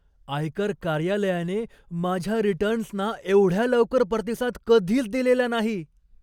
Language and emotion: Marathi, surprised